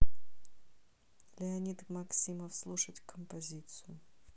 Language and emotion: Russian, neutral